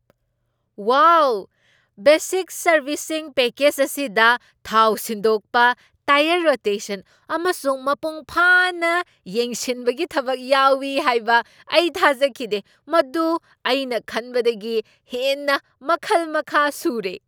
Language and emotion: Manipuri, surprised